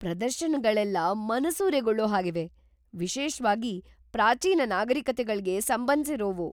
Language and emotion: Kannada, surprised